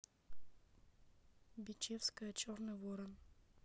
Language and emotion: Russian, neutral